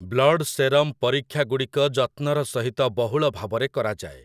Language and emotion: Odia, neutral